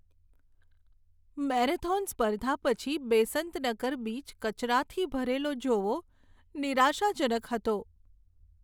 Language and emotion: Gujarati, sad